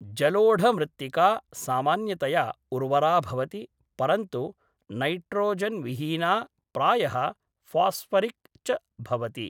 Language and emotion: Sanskrit, neutral